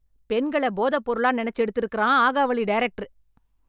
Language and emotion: Tamil, angry